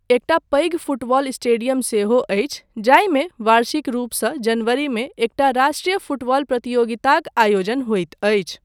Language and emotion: Maithili, neutral